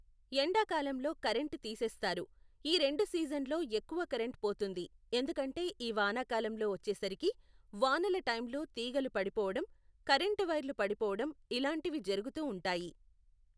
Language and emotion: Telugu, neutral